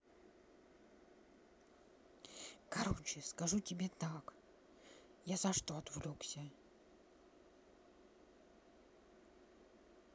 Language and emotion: Russian, neutral